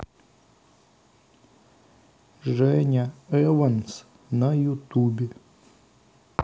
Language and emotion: Russian, sad